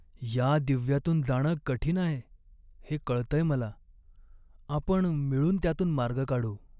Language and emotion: Marathi, sad